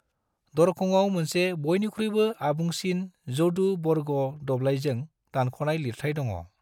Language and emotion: Bodo, neutral